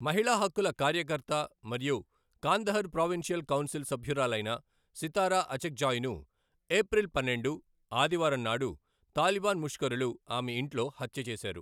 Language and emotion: Telugu, neutral